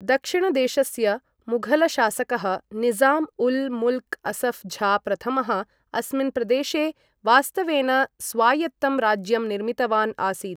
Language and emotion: Sanskrit, neutral